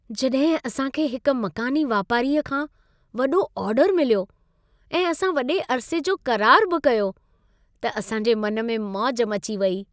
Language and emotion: Sindhi, happy